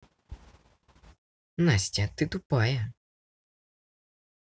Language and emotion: Russian, angry